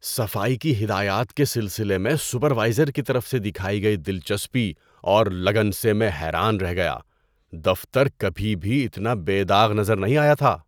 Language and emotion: Urdu, surprised